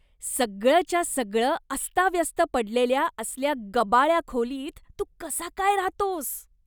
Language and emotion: Marathi, disgusted